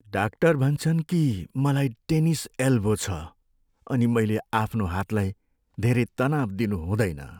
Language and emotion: Nepali, sad